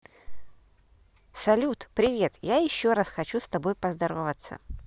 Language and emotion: Russian, positive